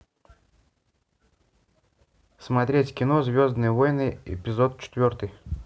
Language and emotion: Russian, neutral